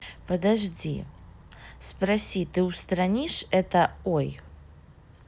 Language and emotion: Russian, neutral